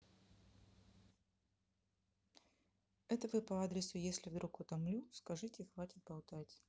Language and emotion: Russian, neutral